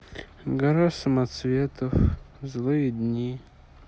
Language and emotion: Russian, sad